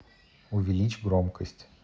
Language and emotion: Russian, neutral